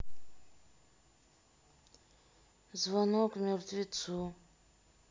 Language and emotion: Russian, sad